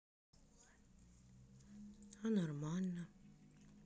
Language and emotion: Russian, sad